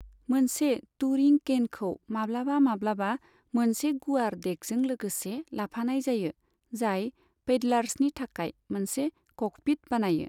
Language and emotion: Bodo, neutral